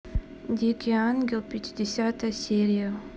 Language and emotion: Russian, neutral